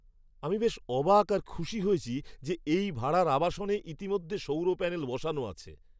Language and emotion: Bengali, surprised